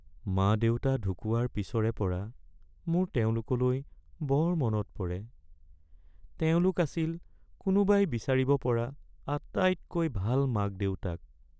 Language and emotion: Assamese, sad